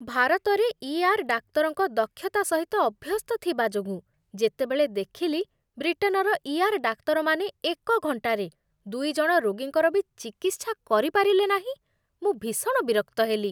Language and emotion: Odia, disgusted